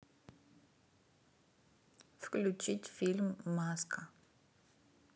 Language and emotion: Russian, neutral